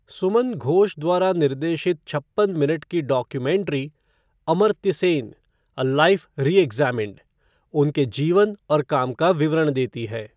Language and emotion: Hindi, neutral